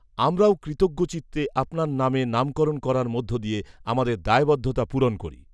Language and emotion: Bengali, neutral